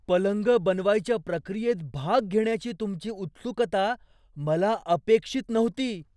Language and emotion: Marathi, surprised